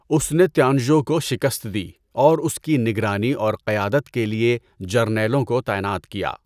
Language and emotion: Urdu, neutral